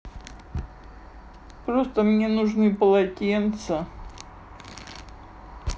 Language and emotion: Russian, sad